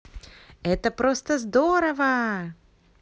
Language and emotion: Russian, positive